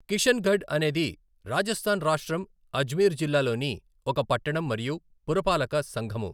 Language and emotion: Telugu, neutral